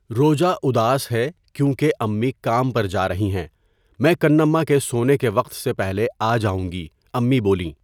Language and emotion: Urdu, neutral